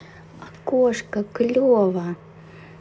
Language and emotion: Russian, positive